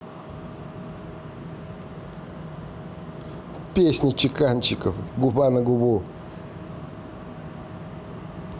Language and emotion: Russian, positive